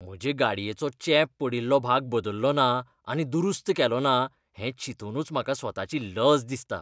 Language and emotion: Goan Konkani, disgusted